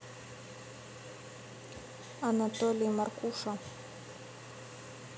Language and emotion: Russian, neutral